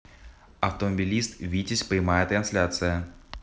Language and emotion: Russian, neutral